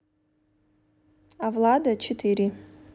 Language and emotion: Russian, neutral